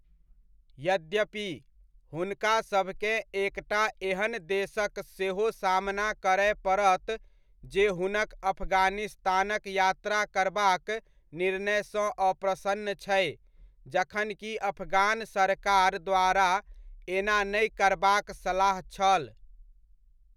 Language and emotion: Maithili, neutral